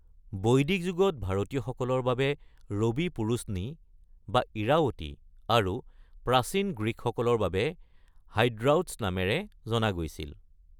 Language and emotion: Assamese, neutral